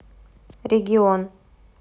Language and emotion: Russian, neutral